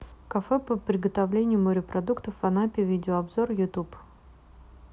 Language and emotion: Russian, neutral